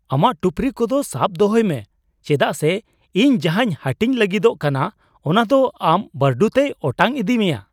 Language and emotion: Santali, surprised